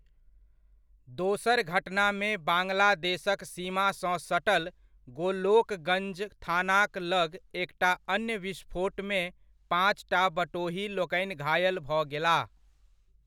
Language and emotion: Maithili, neutral